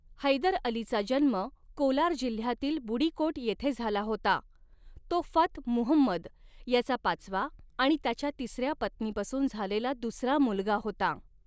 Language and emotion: Marathi, neutral